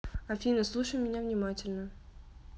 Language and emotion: Russian, neutral